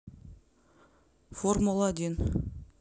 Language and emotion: Russian, neutral